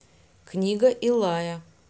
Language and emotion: Russian, neutral